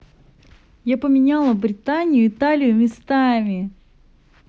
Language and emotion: Russian, positive